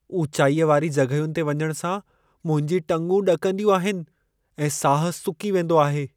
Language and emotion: Sindhi, fearful